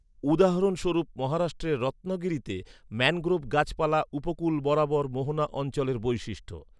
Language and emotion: Bengali, neutral